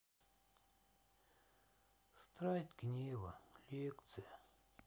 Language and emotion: Russian, sad